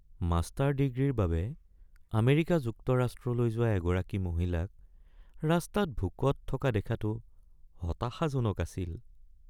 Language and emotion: Assamese, sad